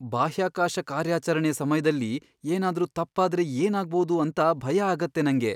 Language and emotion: Kannada, fearful